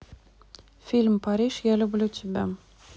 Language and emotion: Russian, neutral